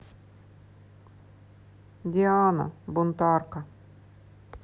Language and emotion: Russian, sad